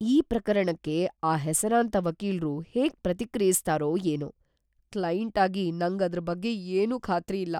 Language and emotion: Kannada, fearful